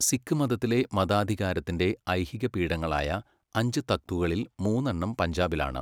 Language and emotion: Malayalam, neutral